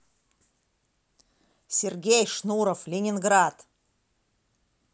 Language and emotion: Russian, angry